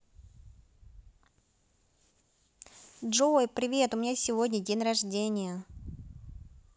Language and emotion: Russian, positive